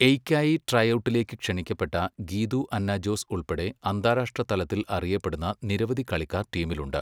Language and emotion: Malayalam, neutral